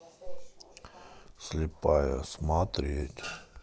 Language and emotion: Russian, neutral